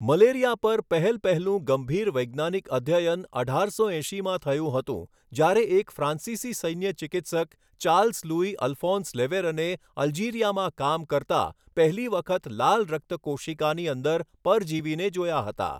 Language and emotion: Gujarati, neutral